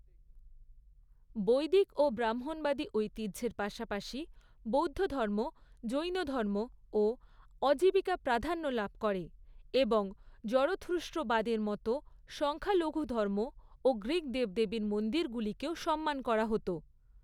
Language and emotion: Bengali, neutral